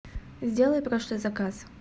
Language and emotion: Russian, neutral